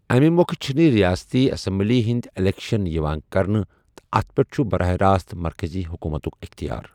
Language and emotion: Kashmiri, neutral